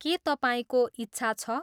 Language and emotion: Nepali, neutral